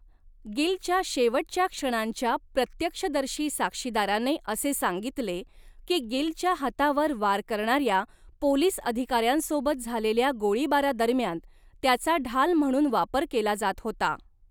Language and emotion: Marathi, neutral